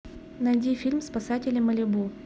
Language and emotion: Russian, neutral